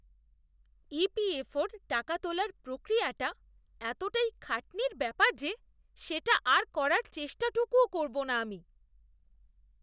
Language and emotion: Bengali, disgusted